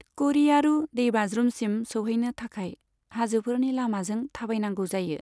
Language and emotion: Bodo, neutral